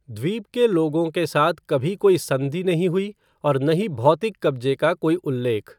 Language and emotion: Hindi, neutral